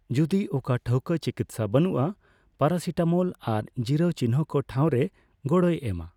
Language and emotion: Santali, neutral